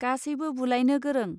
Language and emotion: Bodo, neutral